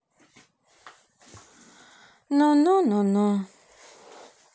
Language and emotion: Russian, sad